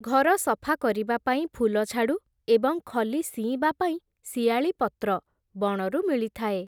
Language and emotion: Odia, neutral